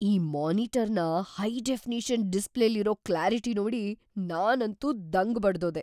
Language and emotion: Kannada, surprised